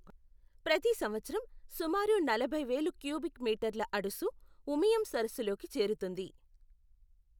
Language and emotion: Telugu, neutral